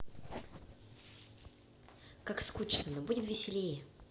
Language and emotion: Russian, neutral